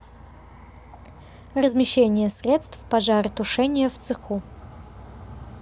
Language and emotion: Russian, neutral